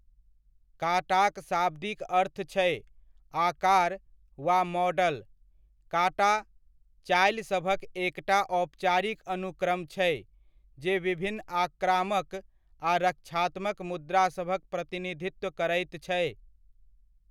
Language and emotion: Maithili, neutral